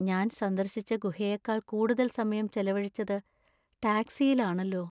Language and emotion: Malayalam, sad